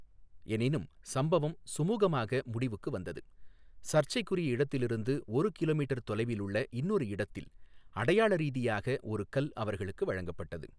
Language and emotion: Tamil, neutral